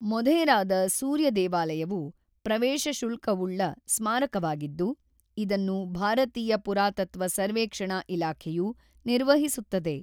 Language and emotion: Kannada, neutral